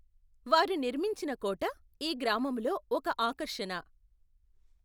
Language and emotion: Telugu, neutral